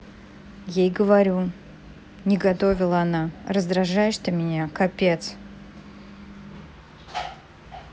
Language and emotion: Russian, angry